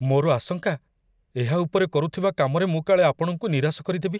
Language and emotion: Odia, fearful